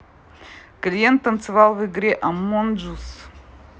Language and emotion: Russian, neutral